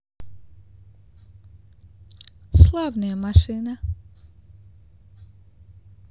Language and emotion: Russian, neutral